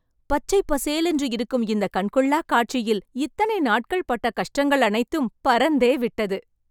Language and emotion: Tamil, happy